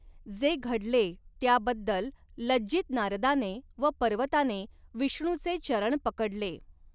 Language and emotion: Marathi, neutral